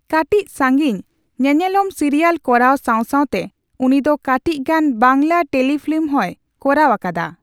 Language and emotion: Santali, neutral